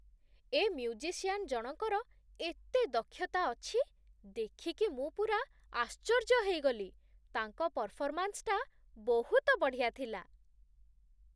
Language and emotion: Odia, surprised